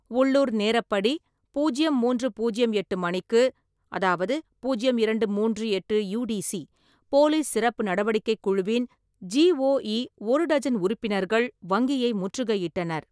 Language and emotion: Tamil, neutral